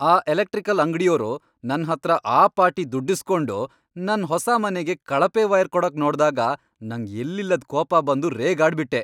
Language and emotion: Kannada, angry